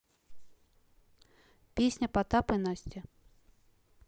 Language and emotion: Russian, neutral